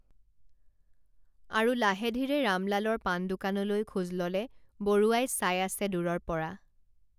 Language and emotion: Assamese, neutral